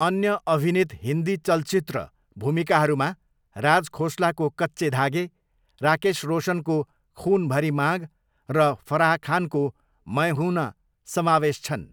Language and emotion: Nepali, neutral